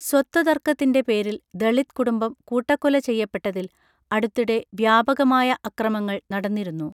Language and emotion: Malayalam, neutral